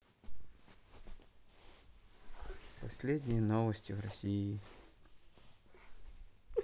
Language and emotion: Russian, neutral